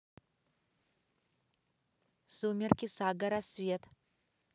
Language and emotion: Russian, neutral